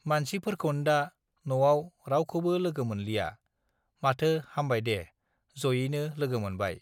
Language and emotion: Bodo, neutral